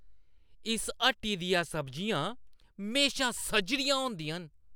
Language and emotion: Dogri, happy